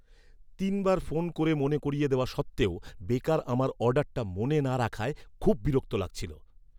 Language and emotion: Bengali, angry